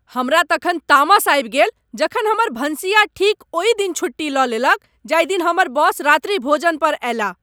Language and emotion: Maithili, angry